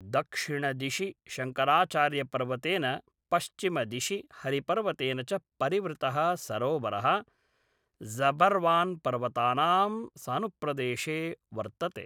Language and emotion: Sanskrit, neutral